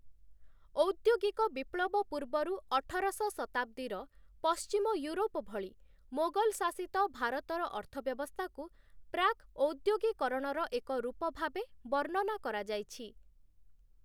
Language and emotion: Odia, neutral